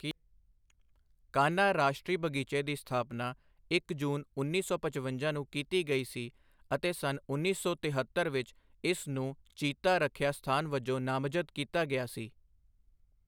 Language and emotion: Punjabi, neutral